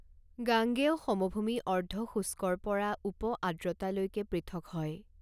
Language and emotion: Assamese, neutral